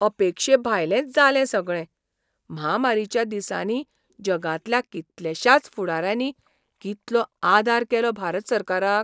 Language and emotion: Goan Konkani, surprised